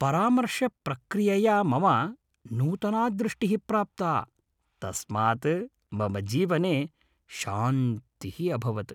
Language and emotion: Sanskrit, happy